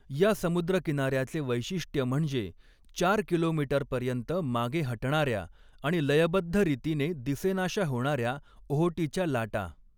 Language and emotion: Marathi, neutral